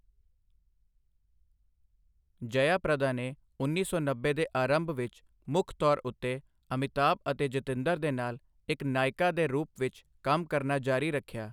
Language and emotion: Punjabi, neutral